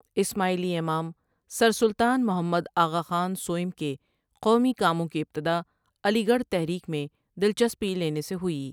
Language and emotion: Urdu, neutral